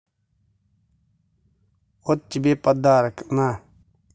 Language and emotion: Russian, angry